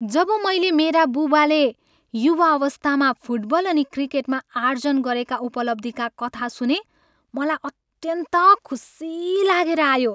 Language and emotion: Nepali, happy